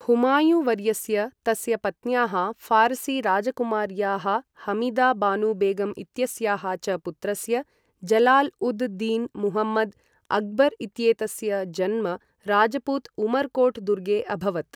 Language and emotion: Sanskrit, neutral